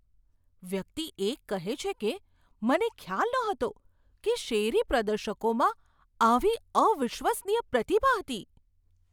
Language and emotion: Gujarati, surprised